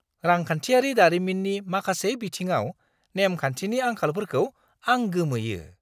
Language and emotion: Bodo, surprised